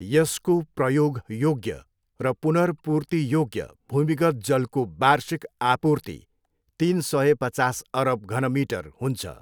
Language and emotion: Nepali, neutral